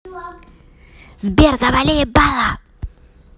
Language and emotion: Russian, angry